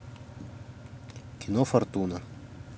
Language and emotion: Russian, neutral